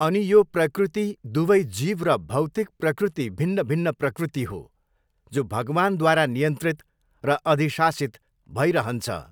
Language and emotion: Nepali, neutral